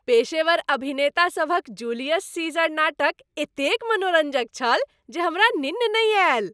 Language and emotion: Maithili, happy